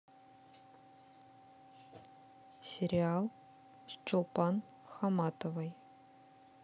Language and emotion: Russian, neutral